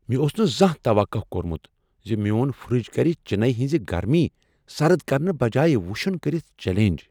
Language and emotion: Kashmiri, surprised